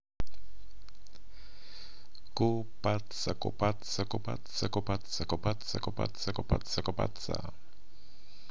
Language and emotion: Russian, positive